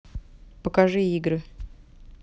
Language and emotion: Russian, neutral